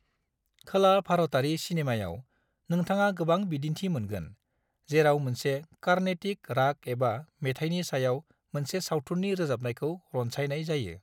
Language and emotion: Bodo, neutral